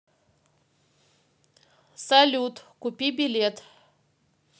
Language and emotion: Russian, neutral